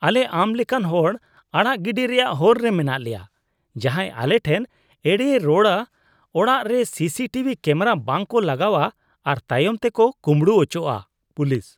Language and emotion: Santali, disgusted